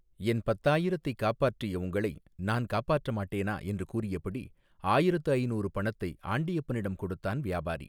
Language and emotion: Tamil, neutral